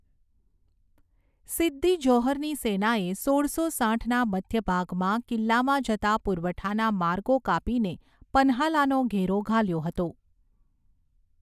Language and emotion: Gujarati, neutral